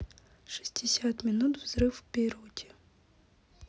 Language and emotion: Russian, neutral